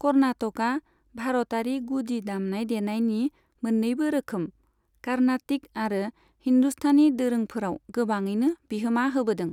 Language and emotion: Bodo, neutral